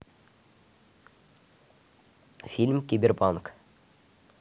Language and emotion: Russian, neutral